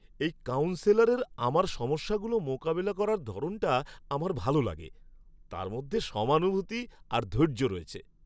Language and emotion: Bengali, happy